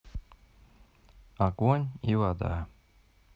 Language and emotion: Russian, neutral